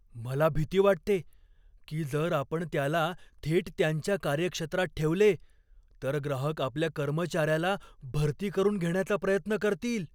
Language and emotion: Marathi, fearful